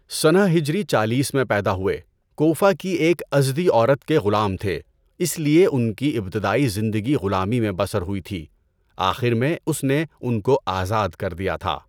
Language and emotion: Urdu, neutral